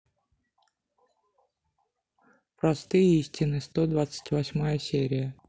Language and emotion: Russian, neutral